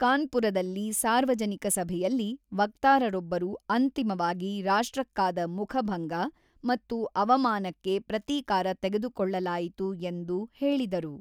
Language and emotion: Kannada, neutral